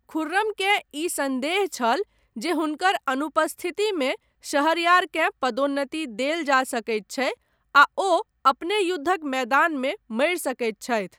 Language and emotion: Maithili, neutral